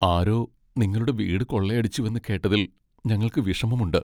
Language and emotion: Malayalam, sad